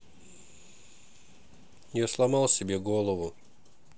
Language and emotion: Russian, sad